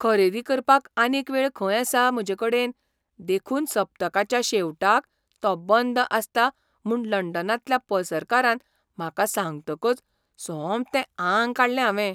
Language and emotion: Goan Konkani, surprised